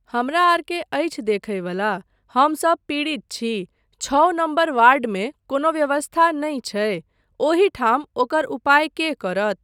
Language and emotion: Maithili, neutral